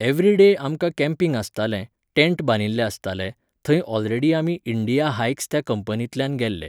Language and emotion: Goan Konkani, neutral